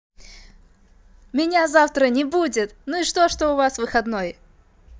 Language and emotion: Russian, positive